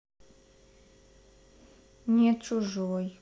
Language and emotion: Russian, sad